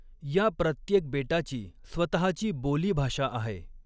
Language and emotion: Marathi, neutral